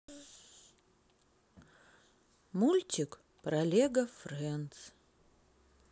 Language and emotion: Russian, sad